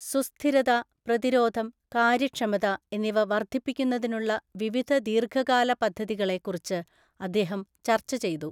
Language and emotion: Malayalam, neutral